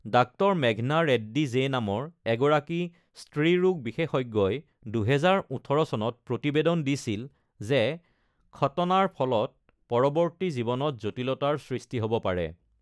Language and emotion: Assamese, neutral